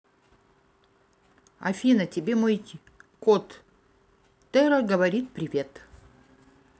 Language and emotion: Russian, neutral